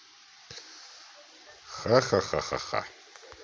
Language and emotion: Russian, positive